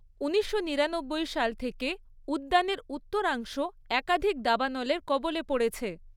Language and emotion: Bengali, neutral